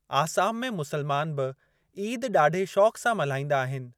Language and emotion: Sindhi, neutral